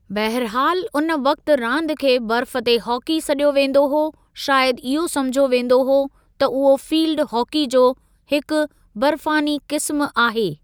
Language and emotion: Sindhi, neutral